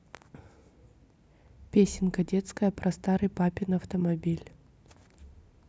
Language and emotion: Russian, neutral